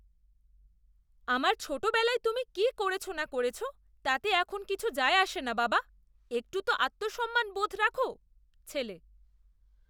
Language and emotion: Bengali, disgusted